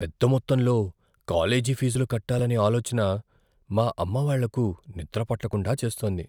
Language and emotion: Telugu, fearful